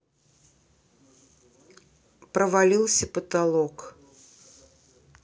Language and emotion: Russian, neutral